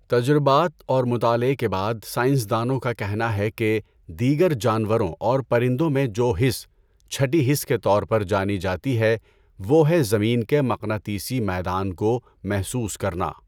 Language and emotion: Urdu, neutral